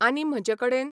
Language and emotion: Goan Konkani, neutral